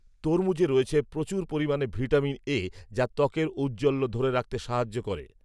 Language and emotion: Bengali, neutral